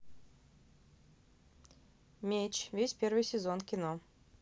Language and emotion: Russian, neutral